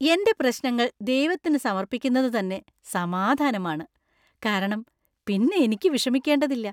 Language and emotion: Malayalam, happy